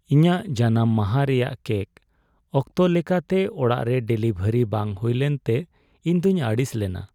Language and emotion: Santali, sad